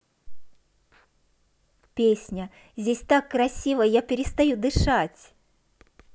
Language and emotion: Russian, positive